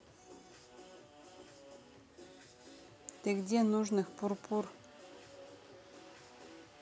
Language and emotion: Russian, neutral